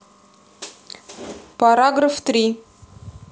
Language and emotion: Russian, neutral